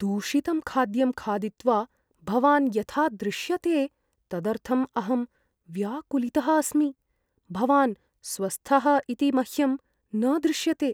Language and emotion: Sanskrit, fearful